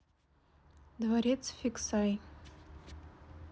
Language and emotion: Russian, neutral